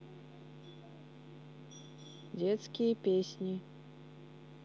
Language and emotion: Russian, neutral